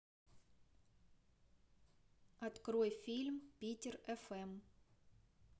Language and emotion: Russian, neutral